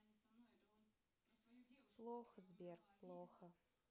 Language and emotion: Russian, neutral